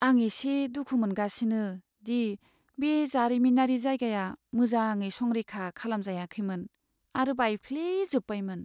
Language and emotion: Bodo, sad